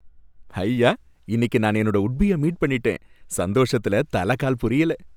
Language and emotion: Tamil, happy